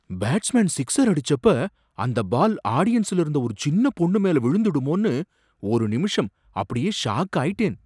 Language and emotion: Tamil, surprised